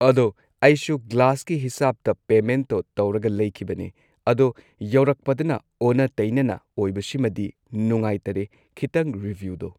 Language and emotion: Manipuri, neutral